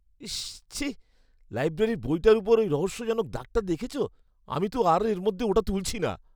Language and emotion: Bengali, disgusted